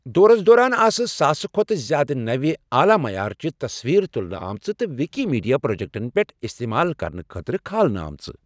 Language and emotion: Kashmiri, neutral